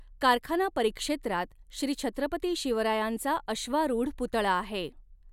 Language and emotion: Marathi, neutral